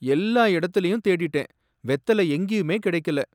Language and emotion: Tamil, sad